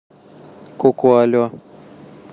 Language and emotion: Russian, neutral